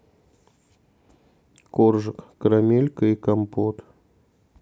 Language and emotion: Russian, sad